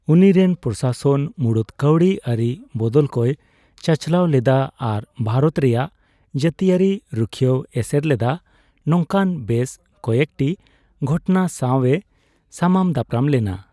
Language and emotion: Santali, neutral